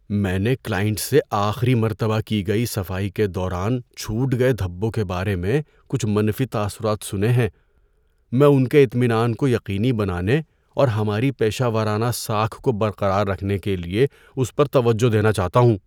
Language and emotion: Urdu, fearful